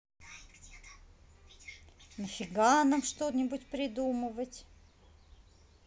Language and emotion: Russian, neutral